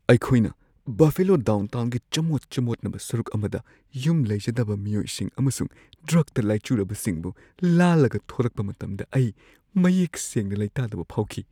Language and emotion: Manipuri, fearful